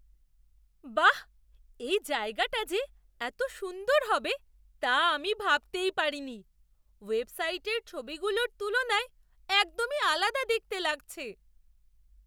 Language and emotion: Bengali, surprised